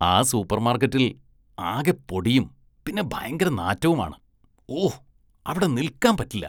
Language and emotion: Malayalam, disgusted